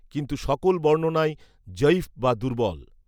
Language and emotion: Bengali, neutral